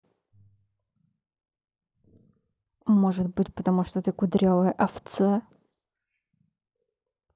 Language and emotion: Russian, angry